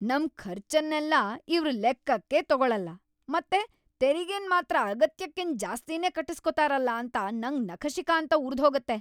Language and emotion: Kannada, angry